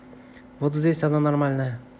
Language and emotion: Russian, neutral